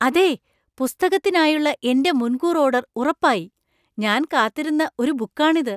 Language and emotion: Malayalam, surprised